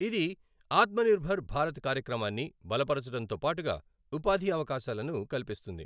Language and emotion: Telugu, neutral